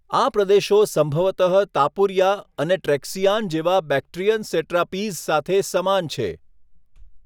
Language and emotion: Gujarati, neutral